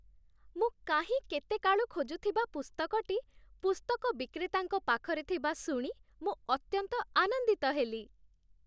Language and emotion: Odia, happy